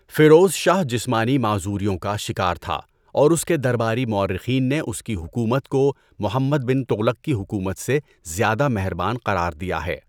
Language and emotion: Urdu, neutral